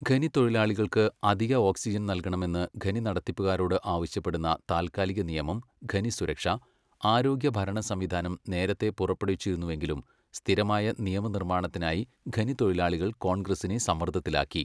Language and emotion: Malayalam, neutral